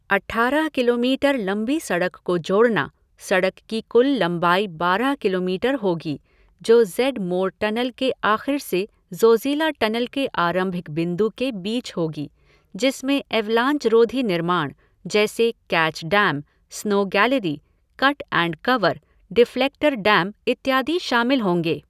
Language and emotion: Hindi, neutral